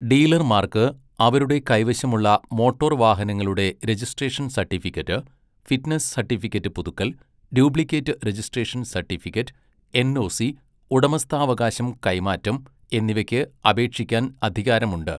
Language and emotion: Malayalam, neutral